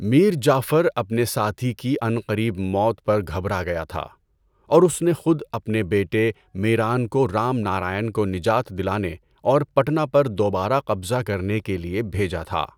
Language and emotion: Urdu, neutral